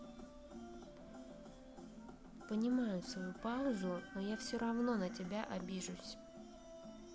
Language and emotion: Russian, sad